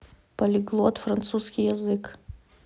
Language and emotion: Russian, neutral